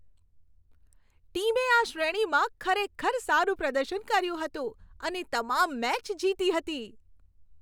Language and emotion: Gujarati, happy